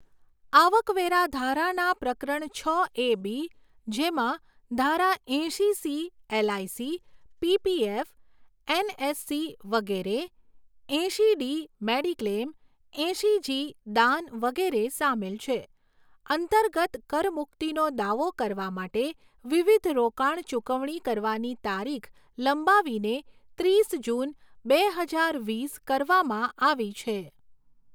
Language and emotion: Gujarati, neutral